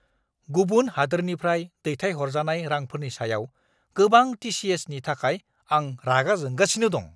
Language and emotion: Bodo, angry